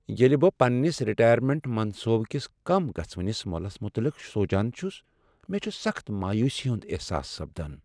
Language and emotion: Kashmiri, sad